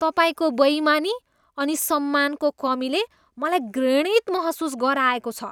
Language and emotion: Nepali, disgusted